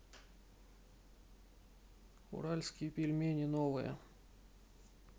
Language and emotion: Russian, neutral